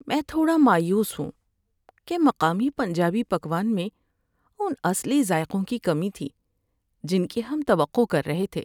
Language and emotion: Urdu, sad